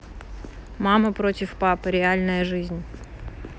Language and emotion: Russian, neutral